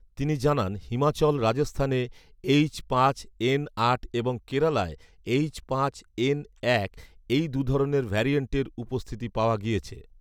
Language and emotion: Bengali, neutral